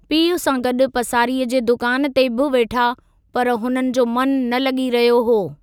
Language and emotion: Sindhi, neutral